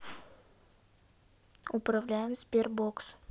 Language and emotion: Russian, neutral